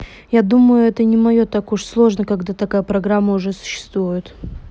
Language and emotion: Russian, neutral